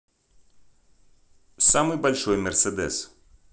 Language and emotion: Russian, neutral